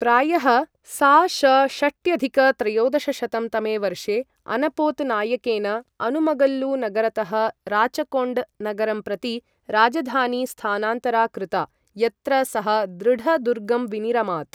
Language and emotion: Sanskrit, neutral